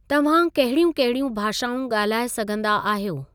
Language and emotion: Sindhi, neutral